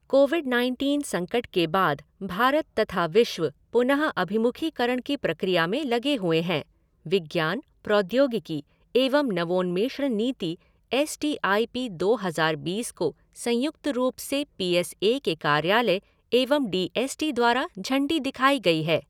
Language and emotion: Hindi, neutral